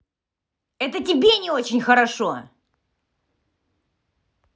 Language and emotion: Russian, angry